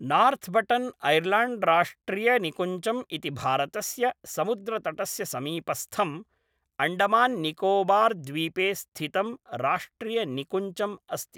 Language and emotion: Sanskrit, neutral